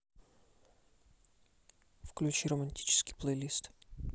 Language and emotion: Russian, neutral